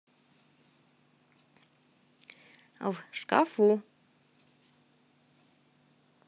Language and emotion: Russian, positive